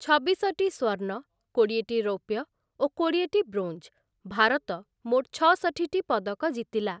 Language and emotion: Odia, neutral